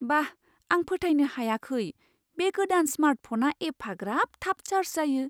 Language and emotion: Bodo, surprised